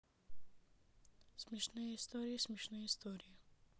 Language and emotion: Russian, neutral